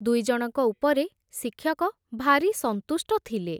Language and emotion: Odia, neutral